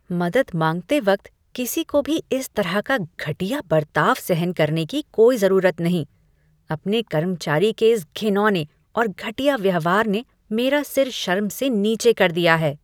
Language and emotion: Hindi, disgusted